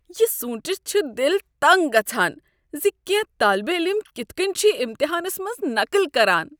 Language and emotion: Kashmiri, disgusted